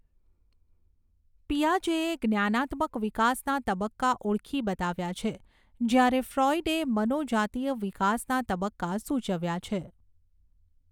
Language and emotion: Gujarati, neutral